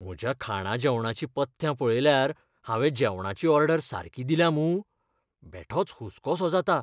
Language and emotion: Goan Konkani, fearful